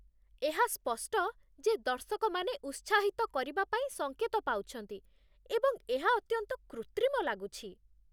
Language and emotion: Odia, disgusted